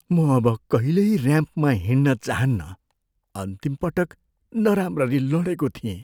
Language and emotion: Nepali, fearful